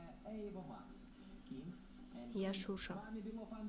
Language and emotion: Russian, neutral